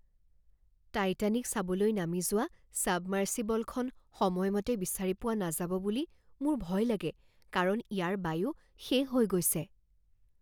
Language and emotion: Assamese, fearful